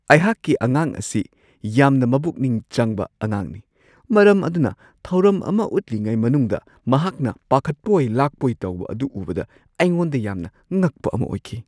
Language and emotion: Manipuri, surprised